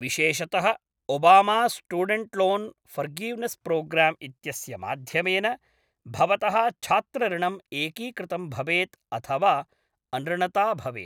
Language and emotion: Sanskrit, neutral